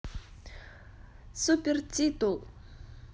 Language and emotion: Russian, positive